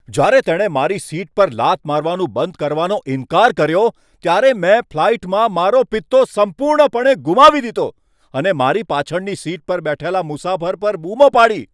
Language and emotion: Gujarati, angry